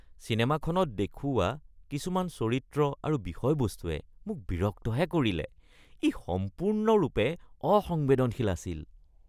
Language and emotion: Assamese, disgusted